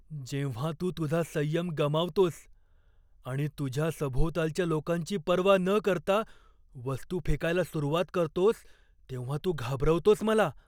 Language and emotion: Marathi, fearful